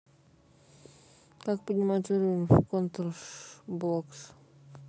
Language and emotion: Russian, neutral